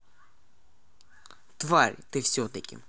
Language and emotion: Russian, neutral